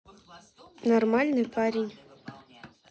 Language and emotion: Russian, neutral